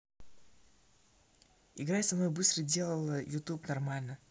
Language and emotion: Russian, neutral